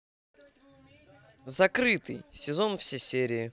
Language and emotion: Russian, angry